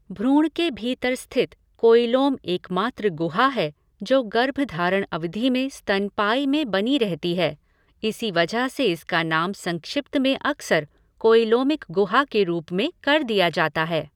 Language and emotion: Hindi, neutral